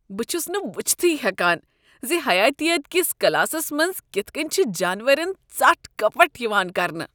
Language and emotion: Kashmiri, disgusted